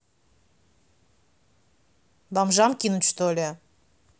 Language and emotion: Russian, angry